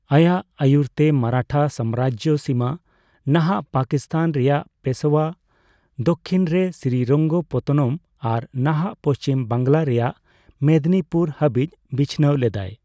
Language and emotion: Santali, neutral